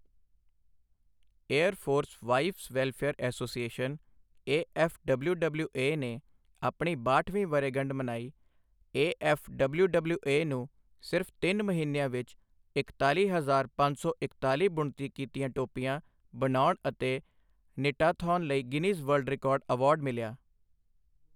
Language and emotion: Punjabi, neutral